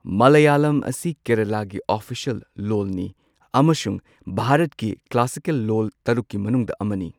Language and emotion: Manipuri, neutral